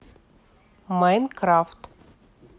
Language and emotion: Russian, neutral